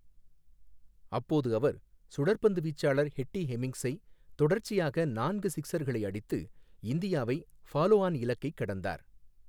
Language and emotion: Tamil, neutral